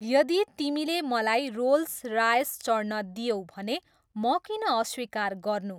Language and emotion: Nepali, neutral